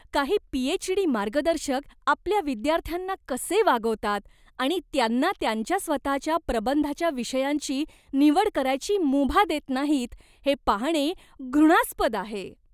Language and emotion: Marathi, disgusted